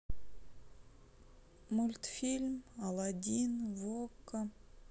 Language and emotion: Russian, sad